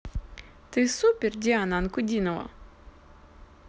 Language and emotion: Russian, positive